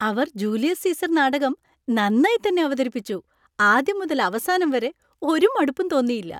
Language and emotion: Malayalam, happy